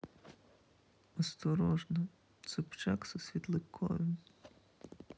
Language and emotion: Russian, sad